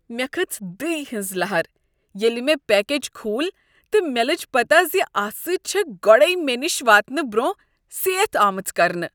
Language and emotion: Kashmiri, disgusted